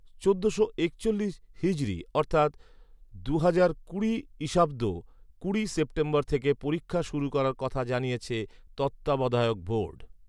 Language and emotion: Bengali, neutral